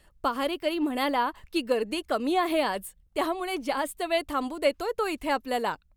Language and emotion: Marathi, happy